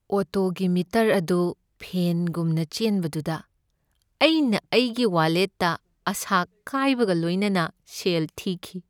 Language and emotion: Manipuri, sad